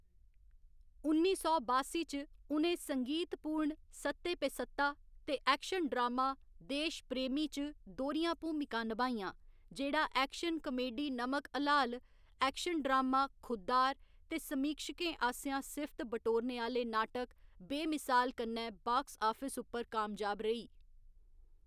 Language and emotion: Dogri, neutral